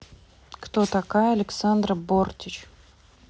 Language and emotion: Russian, neutral